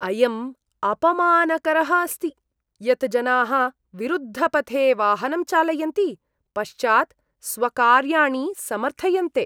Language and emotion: Sanskrit, disgusted